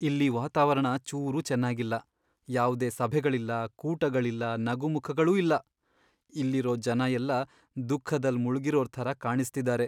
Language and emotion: Kannada, sad